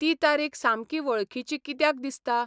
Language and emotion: Goan Konkani, neutral